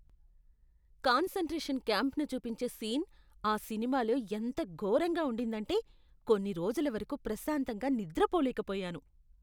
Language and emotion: Telugu, disgusted